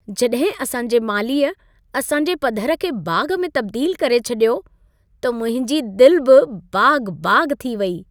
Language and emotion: Sindhi, happy